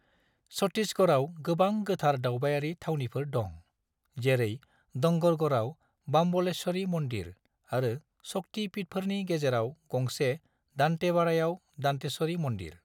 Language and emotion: Bodo, neutral